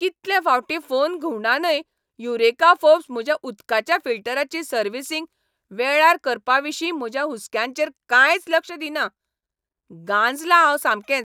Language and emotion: Goan Konkani, angry